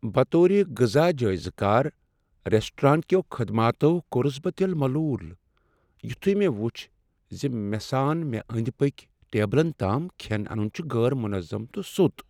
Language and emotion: Kashmiri, sad